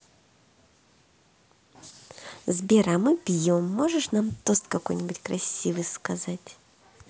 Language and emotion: Russian, positive